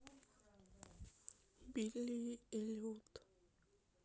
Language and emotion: Russian, sad